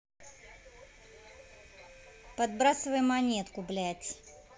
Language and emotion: Russian, angry